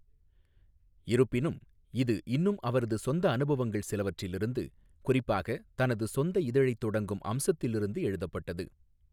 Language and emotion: Tamil, neutral